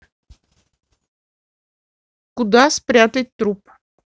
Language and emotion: Russian, neutral